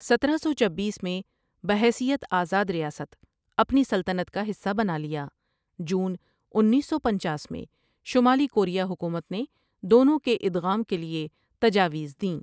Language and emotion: Urdu, neutral